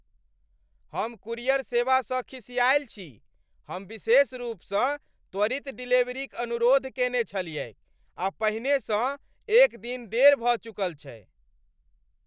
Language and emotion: Maithili, angry